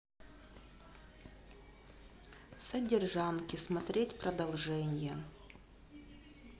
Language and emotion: Russian, sad